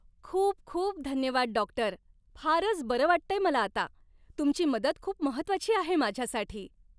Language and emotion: Marathi, happy